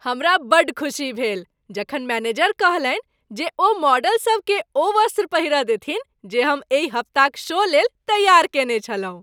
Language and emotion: Maithili, happy